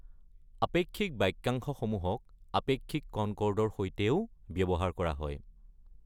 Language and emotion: Assamese, neutral